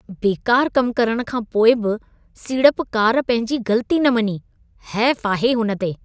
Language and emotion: Sindhi, disgusted